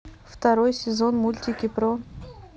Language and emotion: Russian, neutral